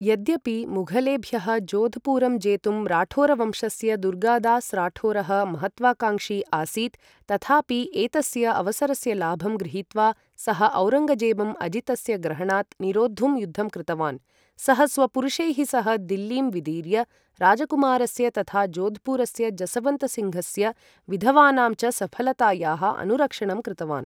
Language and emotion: Sanskrit, neutral